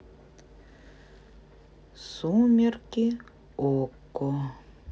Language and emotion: Russian, neutral